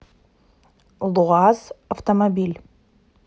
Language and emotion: Russian, neutral